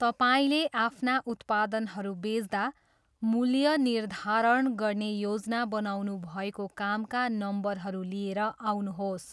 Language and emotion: Nepali, neutral